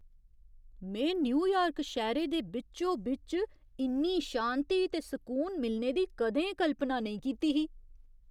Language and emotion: Dogri, surprised